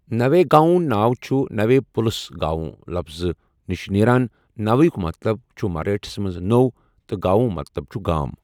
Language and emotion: Kashmiri, neutral